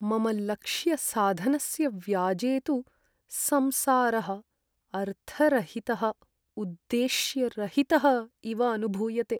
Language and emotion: Sanskrit, sad